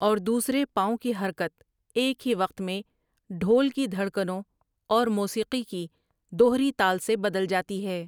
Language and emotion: Urdu, neutral